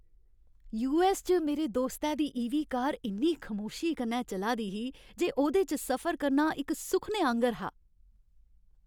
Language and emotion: Dogri, happy